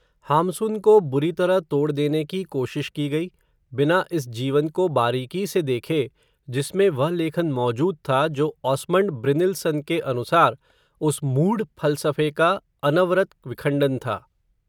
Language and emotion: Hindi, neutral